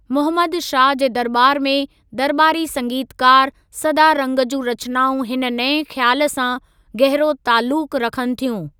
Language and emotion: Sindhi, neutral